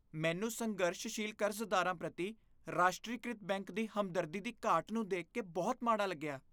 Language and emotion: Punjabi, disgusted